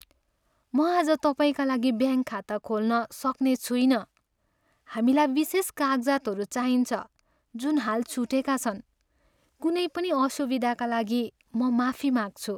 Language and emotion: Nepali, sad